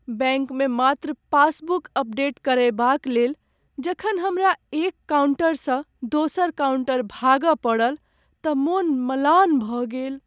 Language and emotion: Maithili, sad